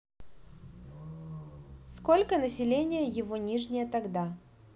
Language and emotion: Russian, neutral